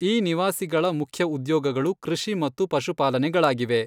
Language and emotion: Kannada, neutral